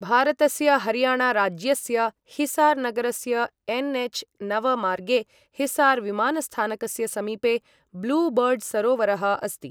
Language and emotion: Sanskrit, neutral